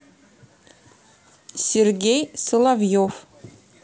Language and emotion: Russian, neutral